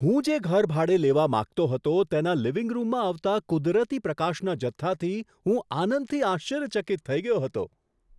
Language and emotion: Gujarati, surprised